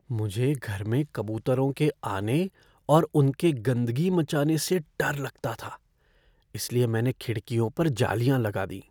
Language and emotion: Hindi, fearful